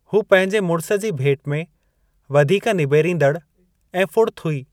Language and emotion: Sindhi, neutral